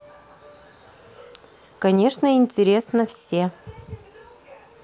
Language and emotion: Russian, neutral